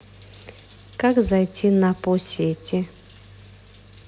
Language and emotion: Russian, neutral